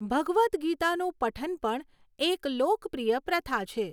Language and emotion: Gujarati, neutral